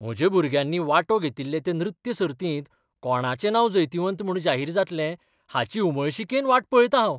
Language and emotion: Goan Konkani, surprised